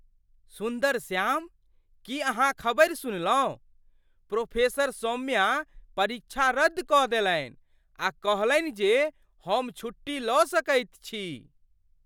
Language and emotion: Maithili, surprised